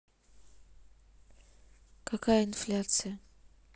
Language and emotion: Russian, neutral